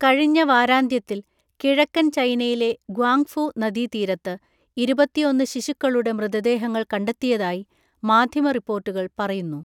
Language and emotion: Malayalam, neutral